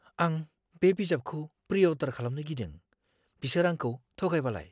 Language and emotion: Bodo, fearful